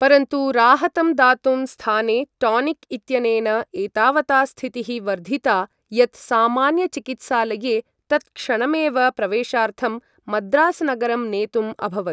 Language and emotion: Sanskrit, neutral